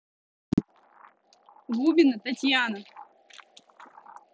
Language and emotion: Russian, neutral